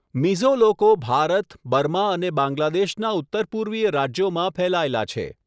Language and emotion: Gujarati, neutral